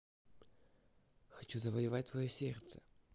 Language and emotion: Russian, positive